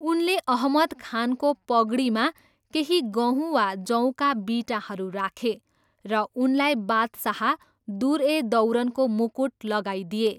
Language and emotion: Nepali, neutral